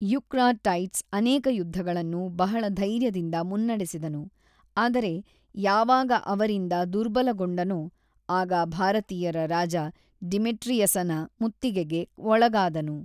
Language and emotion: Kannada, neutral